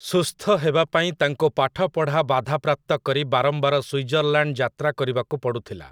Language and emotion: Odia, neutral